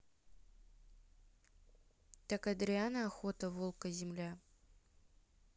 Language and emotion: Russian, neutral